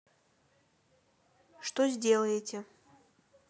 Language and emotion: Russian, neutral